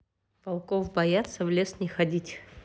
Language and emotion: Russian, neutral